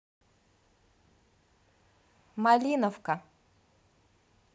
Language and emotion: Russian, neutral